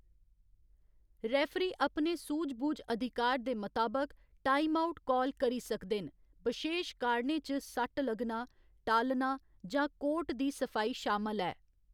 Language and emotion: Dogri, neutral